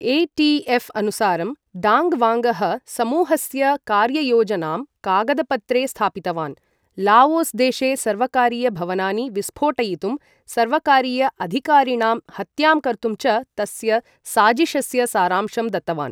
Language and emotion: Sanskrit, neutral